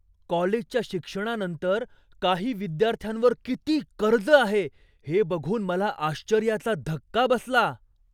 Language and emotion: Marathi, surprised